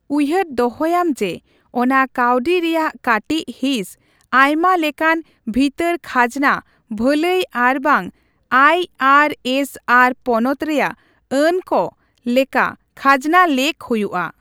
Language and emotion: Santali, neutral